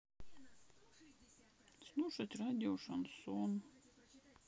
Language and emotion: Russian, sad